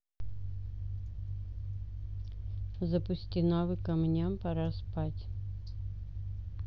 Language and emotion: Russian, neutral